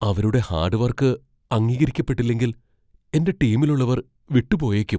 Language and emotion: Malayalam, fearful